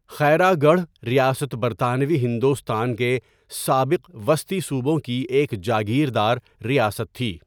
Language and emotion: Urdu, neutral